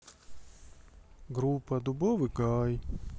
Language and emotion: Russian, sad